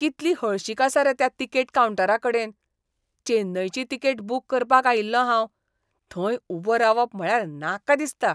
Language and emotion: Goan Konkani, disgusted